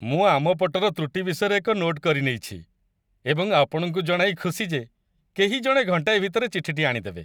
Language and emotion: Odia, happy